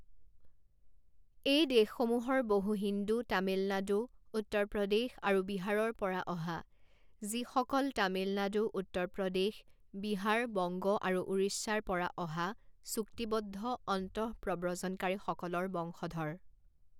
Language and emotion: Assamese, neutral